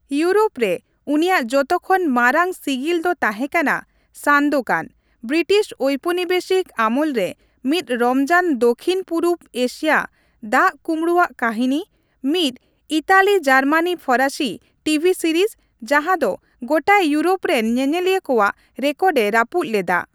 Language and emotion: Santali, neutral